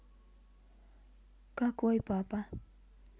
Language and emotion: Russian, neutral